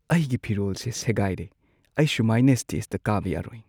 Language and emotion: Manipuri, sad